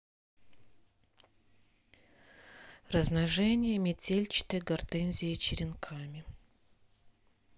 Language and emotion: Russian, neutral